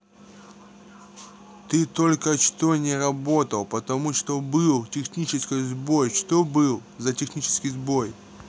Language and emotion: Russian, neutral